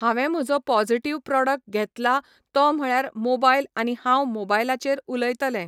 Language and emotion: Goan Konkani, neutral